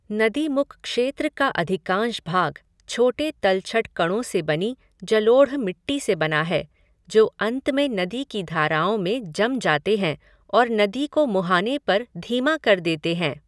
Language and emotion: Hindi, neutral